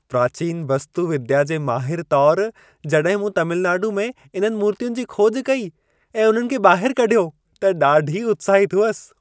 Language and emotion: Sindhi, happy